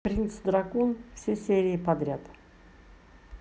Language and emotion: Russian, neutral